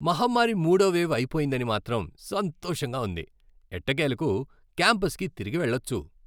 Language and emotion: Telugu, happy